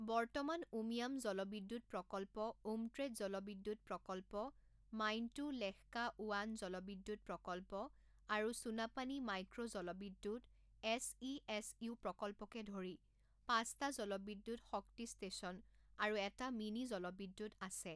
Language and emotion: Assamese, neutral